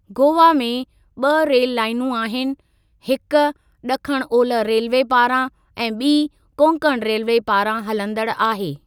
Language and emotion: Sindhi, neutral